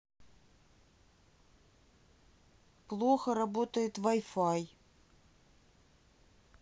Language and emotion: Russian, neutral